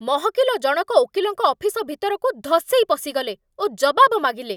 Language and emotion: Odia, angry